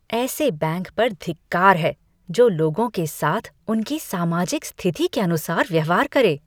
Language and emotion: Hindi, disgusted